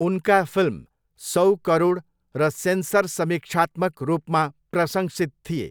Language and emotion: Nepali, neutral